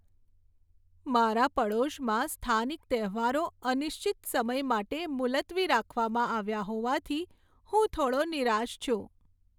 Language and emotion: Gujarati, sad